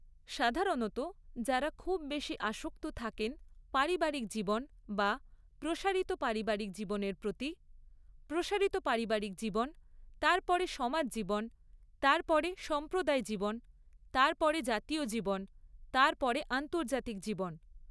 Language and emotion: Bengali, neutral